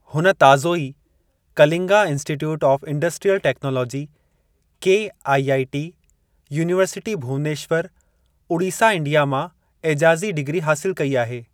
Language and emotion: Sindhi, neutral